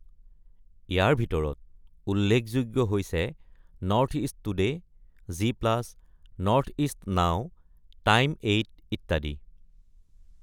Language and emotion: Assamese, neutral